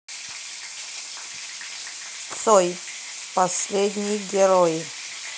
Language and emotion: Russian, neutral